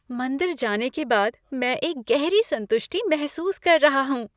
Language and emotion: Hindi, happy